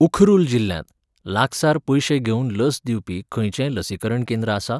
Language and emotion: Goan Konkani, neutral